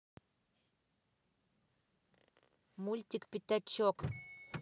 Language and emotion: Russian, neutral